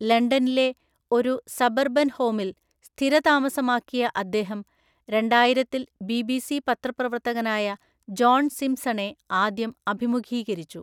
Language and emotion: Malayalam, neutral